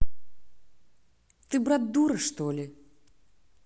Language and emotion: Russian, angry